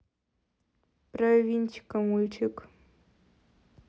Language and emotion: Russian, neutral